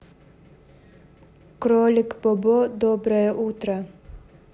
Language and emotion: Russian, neutral